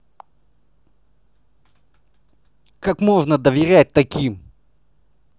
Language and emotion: Russian, angry